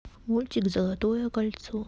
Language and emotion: Russian, neutral